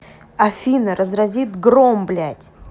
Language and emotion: Russian, angry